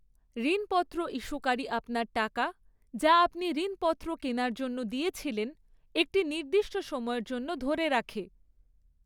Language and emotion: Bengali, neutral